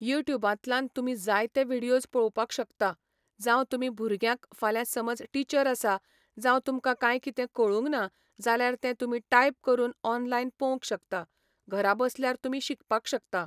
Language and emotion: Goan Konkani, neutral